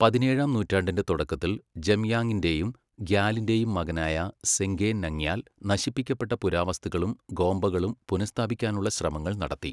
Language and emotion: Malayalam, neutral